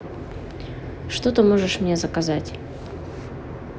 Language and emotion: Russian, neutral